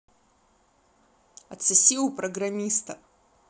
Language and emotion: Russian, angry